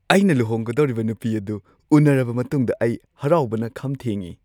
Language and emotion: Manipuri, happy